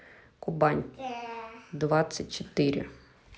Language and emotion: Russian, neutral